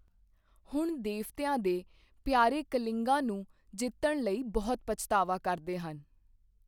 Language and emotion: Punjabi, neutral